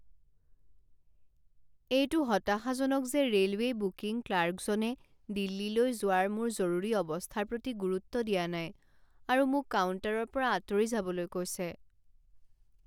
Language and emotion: Assamese, sad